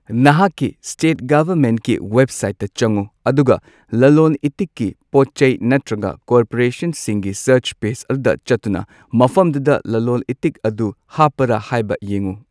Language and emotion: Manipuri, neutral